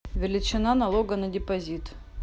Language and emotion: Russian, neutral